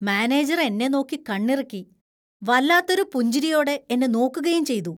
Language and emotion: Malayalam, disgusted